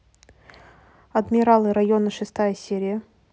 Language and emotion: Russian, neutral